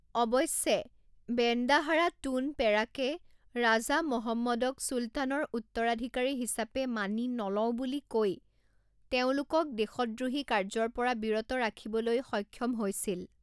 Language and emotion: Assamese, neutral